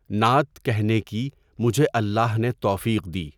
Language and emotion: Urdu, neutral